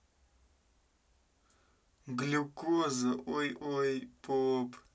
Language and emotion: Russian, neutral